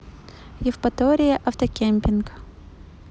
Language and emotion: Russian, neutral